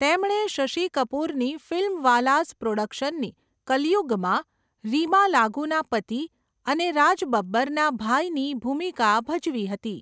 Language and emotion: Gujarati, neutral